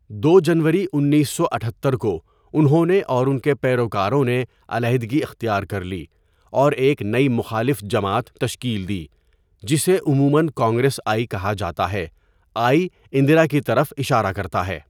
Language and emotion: Urdu, neutral